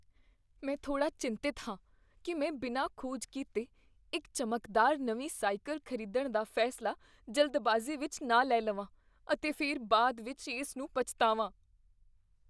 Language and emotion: Punjabi, fearful